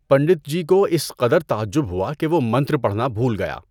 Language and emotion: Urdu, neutral